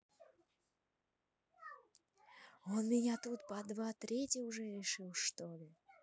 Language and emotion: Russian, neutral